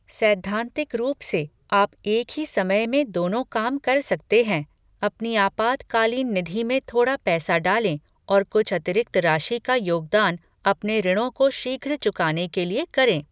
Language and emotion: Hindi, neutral